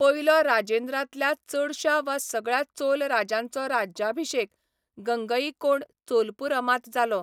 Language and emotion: Goan Konkani, neutral